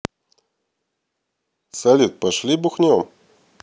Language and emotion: Russian, neutral